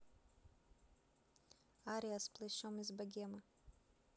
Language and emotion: Russian, neutral